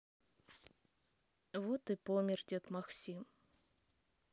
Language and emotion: Russian, sad